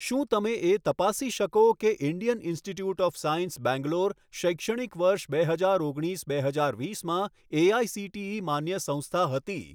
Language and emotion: Gujarati, neutral